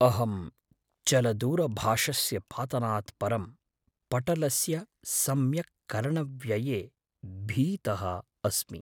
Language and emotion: Sanskrit, fearful